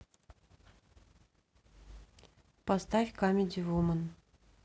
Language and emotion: Russian, neutral